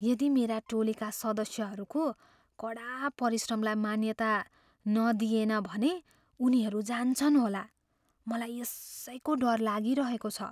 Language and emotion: Nepali, fearful